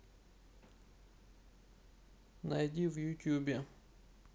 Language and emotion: Russian, neutral